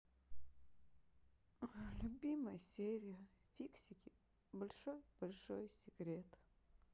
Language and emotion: Russian, sad